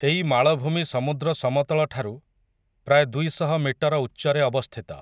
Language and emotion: Odia, neutral